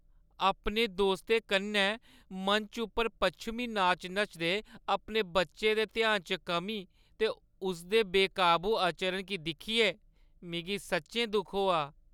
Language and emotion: Dogri, sad